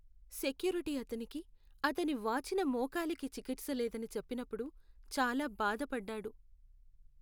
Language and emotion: Telugu, sad